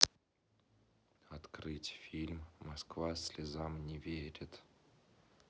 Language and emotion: Russian, neutral